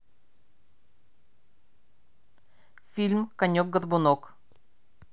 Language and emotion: Russian, neutral